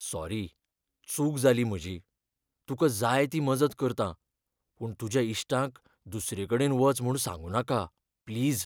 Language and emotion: Goan Konkani, fearful